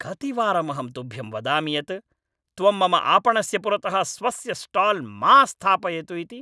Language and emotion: Sanskrit, angry